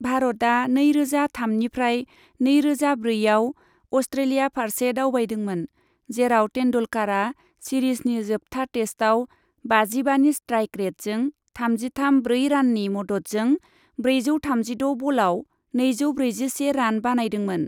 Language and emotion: Bodo, neutral